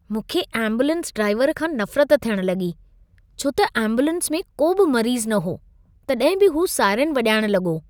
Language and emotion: Sindhi, disgusted